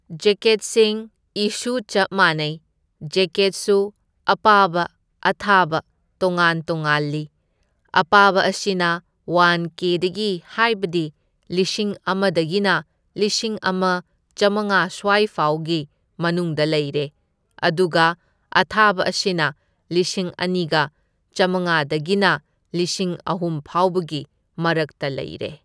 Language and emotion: Manipuri, neutral